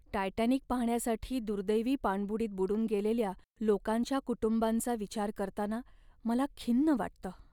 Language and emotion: Marathi, sad